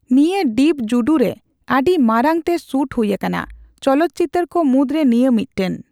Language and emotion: Santali, neutral